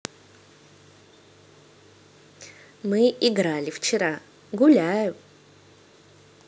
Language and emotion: Russian, neutral